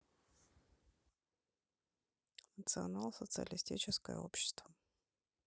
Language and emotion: Russian, neutral